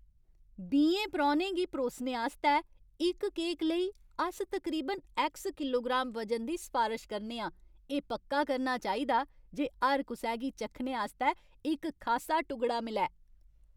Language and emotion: Dogri, happy